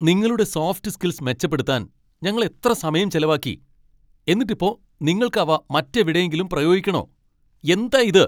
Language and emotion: Malayalam, angry